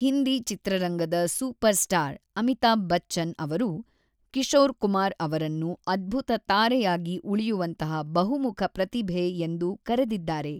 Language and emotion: Kannada, neutral